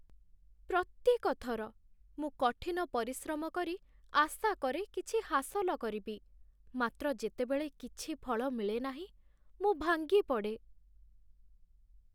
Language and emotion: Odia, sad